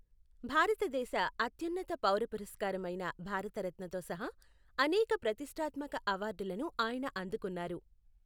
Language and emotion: Telugu, neutral